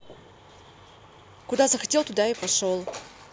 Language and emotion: Russian, angry